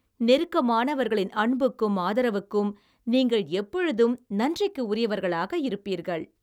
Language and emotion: Tamil, happy